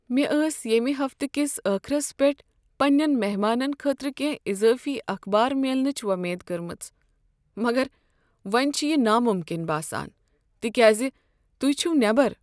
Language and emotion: Kashmiri, sad